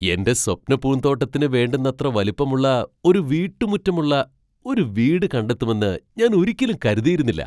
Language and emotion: Malayalam, surprised